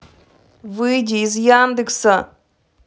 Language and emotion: Russian, angry